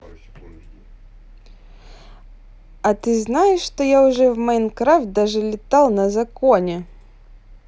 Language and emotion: Russian, positive